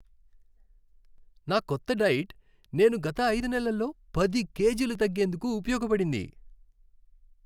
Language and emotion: Telugu, happy